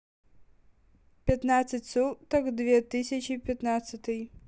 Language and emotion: Russian, neutral